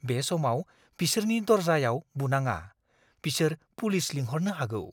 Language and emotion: Bodo, fearful